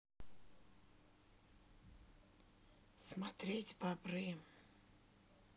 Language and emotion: Russian, neutral